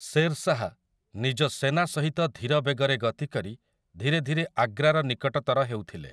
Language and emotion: Odia, neutral